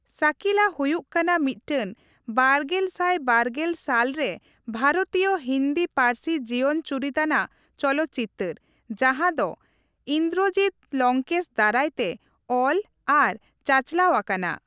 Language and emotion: Santali, neutral